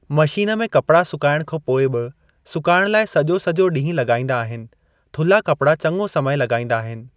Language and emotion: Sindhi, neutral